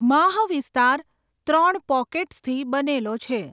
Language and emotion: Gujarati, neutral